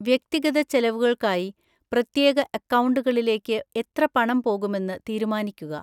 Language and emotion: Malayalam, neutral